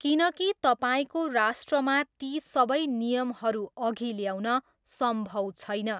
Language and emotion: Nepali, neutral